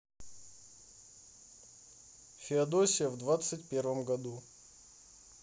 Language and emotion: Russian, neutral